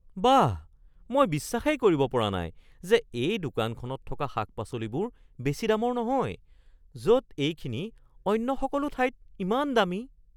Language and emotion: Assamese, surprised